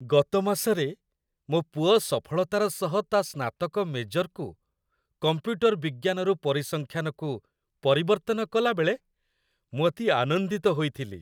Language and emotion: Odia, happy